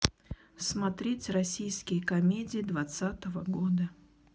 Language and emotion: Russian, neutral